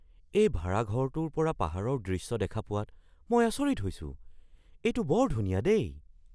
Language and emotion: Assamese, surprised